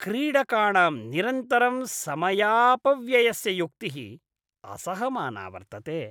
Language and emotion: Sanskrit, disgusted